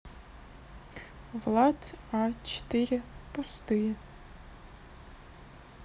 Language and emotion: Russian, neutral